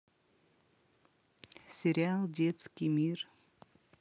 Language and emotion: Russian, neutral